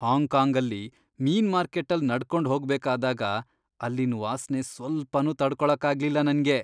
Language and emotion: Kannada, disgusted